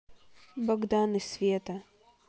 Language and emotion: Russian, neutral